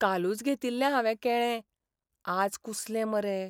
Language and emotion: Goan Konkani, sad